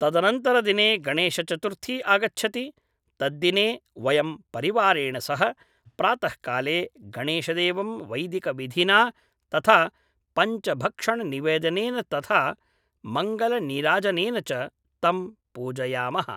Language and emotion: Sanskrit, neutral